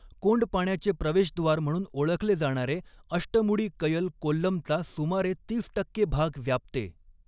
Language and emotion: Marathi, neutral